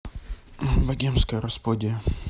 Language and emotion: Russian, neutral